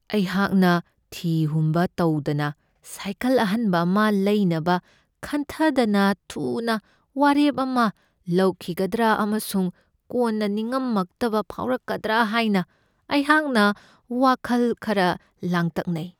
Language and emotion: Manipuri, fearful